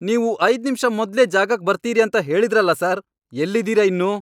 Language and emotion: Kannada, angry